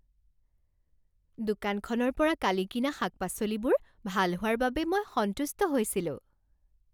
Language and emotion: Assamese, happy